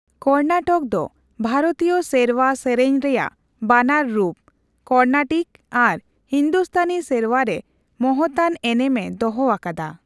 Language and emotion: Santali, neutral